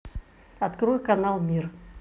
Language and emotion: Russian, neutral